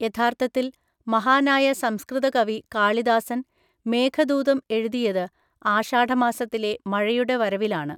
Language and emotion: Malayalam, neutral